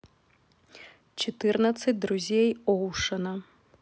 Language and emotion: Russian, neutral